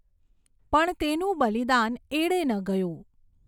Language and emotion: Gujarati, neutral